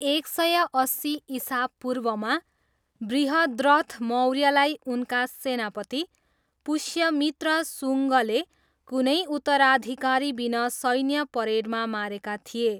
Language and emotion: Nepali, neutral